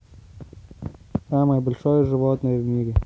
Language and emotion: Russian, neutral